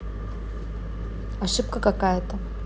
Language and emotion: Russian, neutral